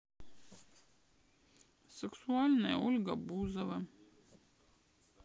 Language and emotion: Russian, sad